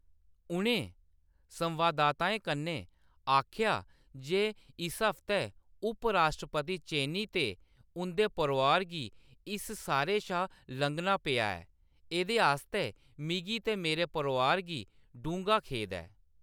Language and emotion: Dogri, neutral